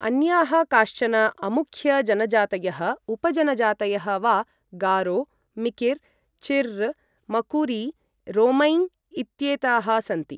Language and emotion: Sanskrit, neutral